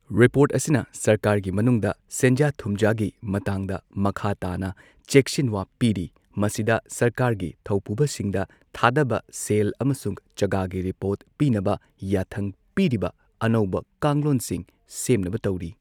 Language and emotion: Manipuri, neutral